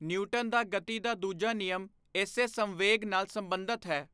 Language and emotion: Punjabi, neutral